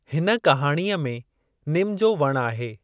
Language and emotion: Sindhi, neutral